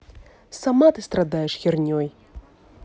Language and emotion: Russian, angry